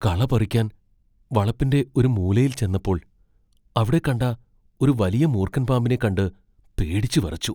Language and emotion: Malayalam, fearful